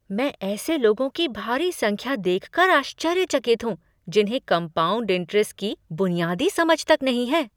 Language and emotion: Hindi, surprised